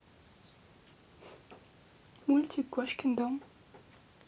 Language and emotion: Russian, neutral